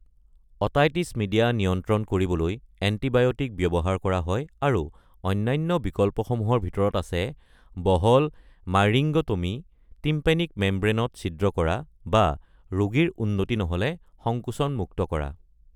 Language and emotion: Assamese, neutral